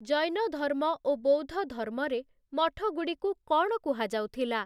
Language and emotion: Odia, neutral